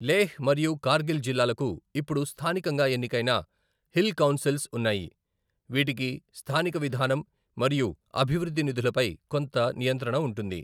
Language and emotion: Telugu, neutral